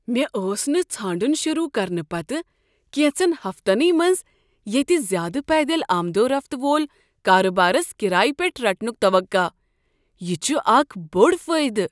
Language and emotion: Kashmiri, surprised